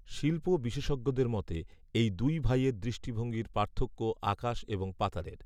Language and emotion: Bengali, neutral